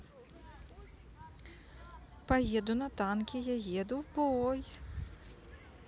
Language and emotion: Russian, positive